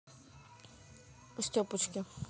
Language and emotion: Russian, neutral